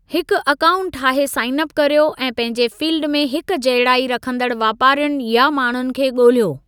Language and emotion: Sindhi, neutral